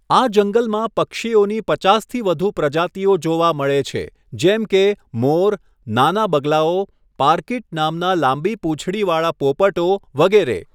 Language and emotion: Gujarati, neutral